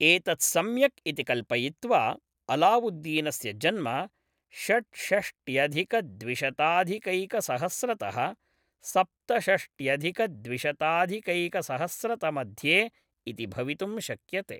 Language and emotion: Sanskrit, neutral